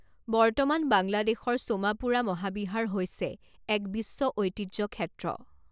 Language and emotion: Assamese, neutral